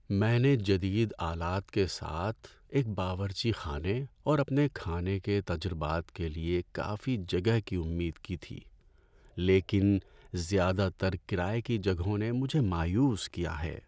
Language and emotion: Urdu, sad